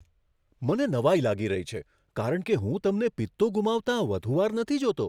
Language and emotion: Gujarati, surprised